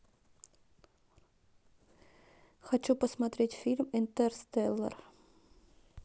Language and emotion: Russian, neutral